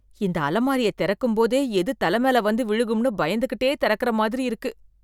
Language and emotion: Tamil, fearful